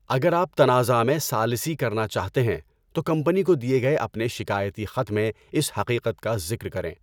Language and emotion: Urdu, neutral